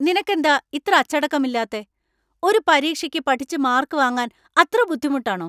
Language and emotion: Malayalam, angry